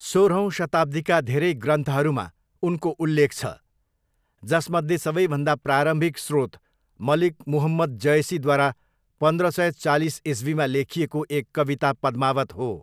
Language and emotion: Nepali, neutral